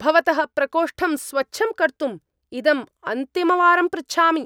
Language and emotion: Sanskrit, angry